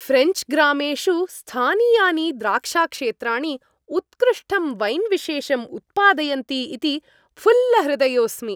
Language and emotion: Sanskrit, happy